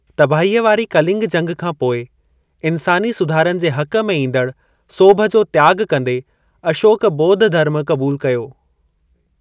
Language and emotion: Sindhi, neutral